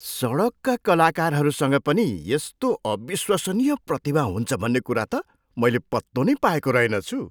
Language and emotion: Nepali, surprised